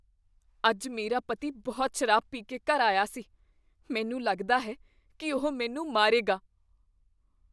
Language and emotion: Punjabi, fearful